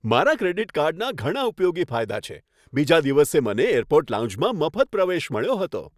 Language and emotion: Gujarati, happy